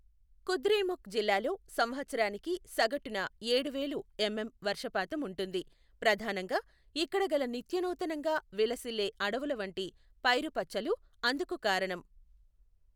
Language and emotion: Telugu, neutral